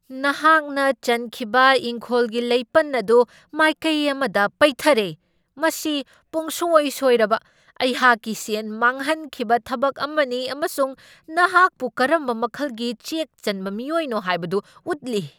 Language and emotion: Manipuri, angry